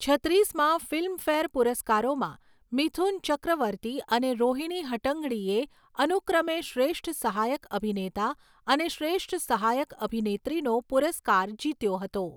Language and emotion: Gujarati, neutral